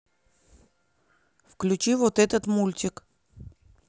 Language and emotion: Russian, angry